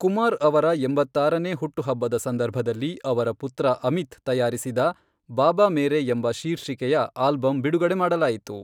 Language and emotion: Kannada, neutral